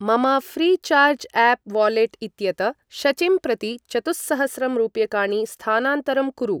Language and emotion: Sanskrit, neutral